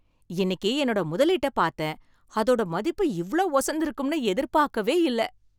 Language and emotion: Tamil, surprised